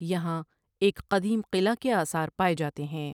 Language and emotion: Urdu, neutral